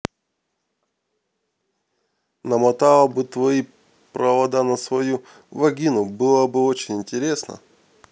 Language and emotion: Russian, neutral